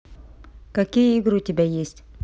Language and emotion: Russian, neutral